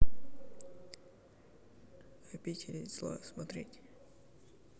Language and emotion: Russian, neutral